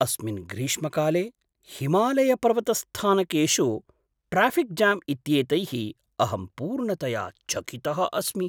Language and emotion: Sanskrit, surprised